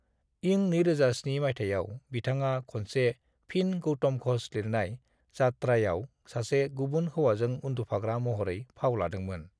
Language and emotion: Bodo, neutral